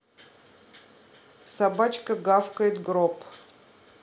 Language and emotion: Russian, neutral